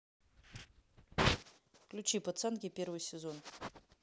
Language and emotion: Russian, neutral